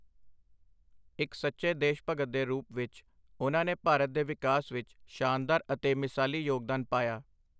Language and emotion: Punjabi, neutral